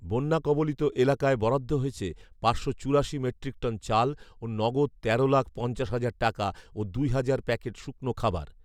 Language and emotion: Bengali, neutral